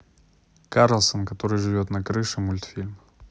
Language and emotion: Russian, neutral